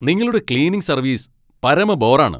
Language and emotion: Malayalam, angry